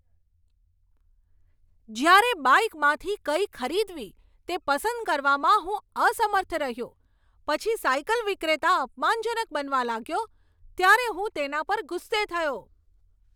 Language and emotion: Gujarati, angry